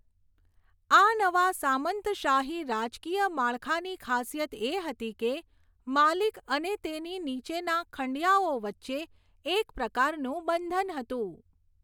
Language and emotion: Gujarati, neutral